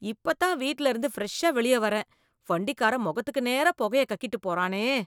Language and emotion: Tamil, disgusted